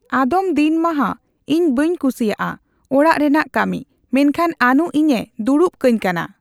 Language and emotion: Santali, neutral